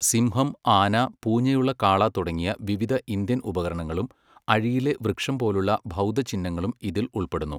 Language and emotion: Malayalam, neutral